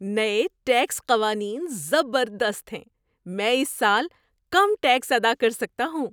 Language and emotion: Urdu, surprised